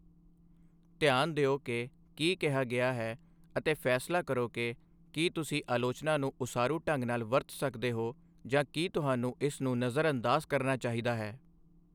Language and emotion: Punjabi, neutral